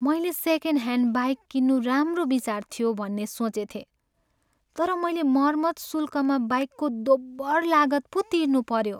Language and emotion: Nepali, sad